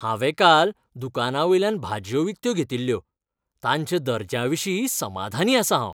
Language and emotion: Goan Konkani, happy